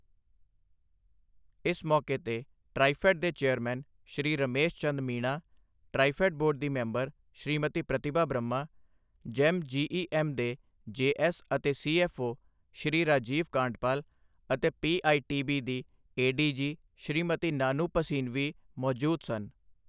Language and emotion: Punjabi, neutral